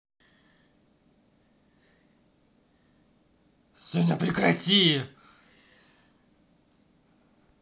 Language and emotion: Russian, angry